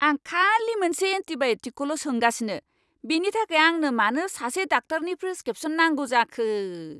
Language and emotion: Bodo, angry